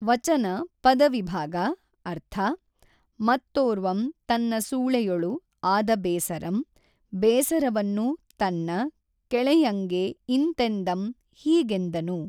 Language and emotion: Kannada, neutral